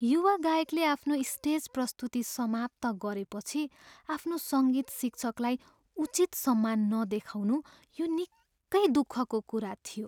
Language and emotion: Nepali, sad